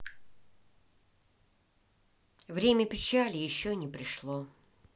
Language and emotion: Russian, sad